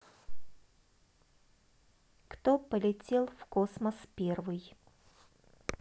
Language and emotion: Russian, neutral